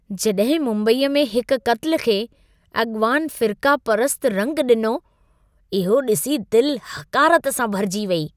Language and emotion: Sindhi, disgusted